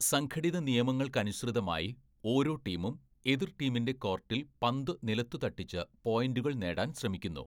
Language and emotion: Malayalam, neutral